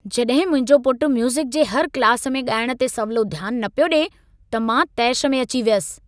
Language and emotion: Sindhi, angry